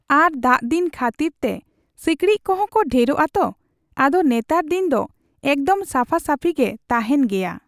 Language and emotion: Santali, neutral